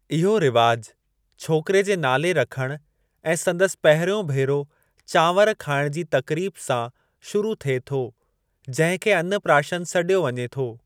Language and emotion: Sindhi, neutral